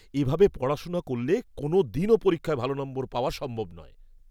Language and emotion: Bengali, disgusted